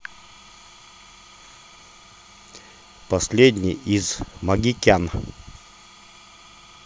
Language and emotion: Russian, neutral